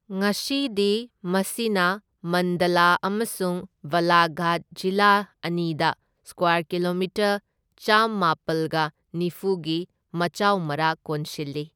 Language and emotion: Manipuri, neutral